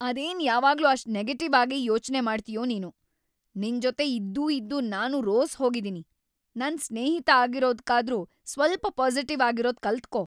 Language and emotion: Kannada, angry